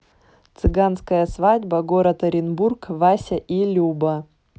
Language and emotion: Russian, neutral